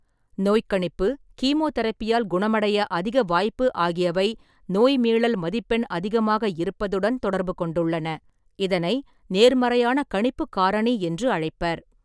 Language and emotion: Tamil, neutral